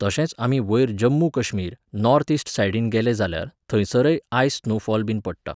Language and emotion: Goan Konkani, neutral